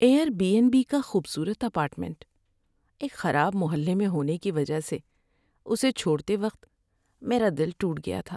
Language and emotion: Urdu, sad